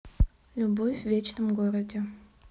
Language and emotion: Russian, neutral